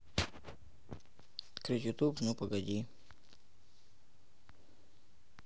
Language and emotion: Russian, neutral